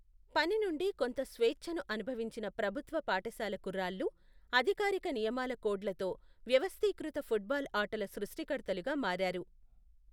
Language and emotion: Telugu, neutral